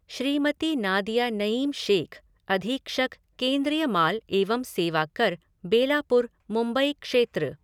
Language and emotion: Hindi, neutral